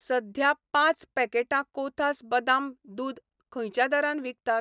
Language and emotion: Goan Konkani, neutral